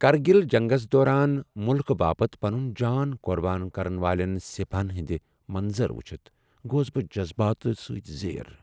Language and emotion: Kashmiri, sad